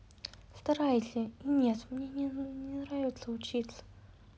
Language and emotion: Russian, sad